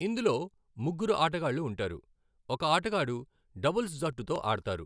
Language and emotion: Telugu, neutral